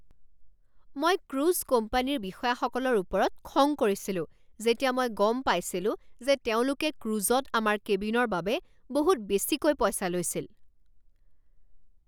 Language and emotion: Assamese, angry